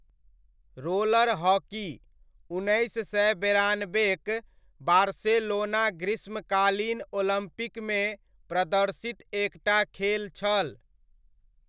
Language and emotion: Maithili, neutral